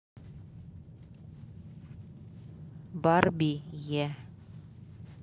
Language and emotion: Russian, neutral